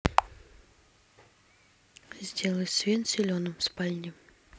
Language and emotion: Russian, neutral